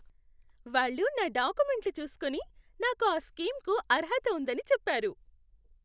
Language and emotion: Telugu, happy